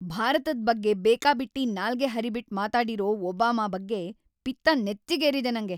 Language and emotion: Kannada, angry